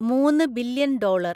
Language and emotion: Malayalam, neutral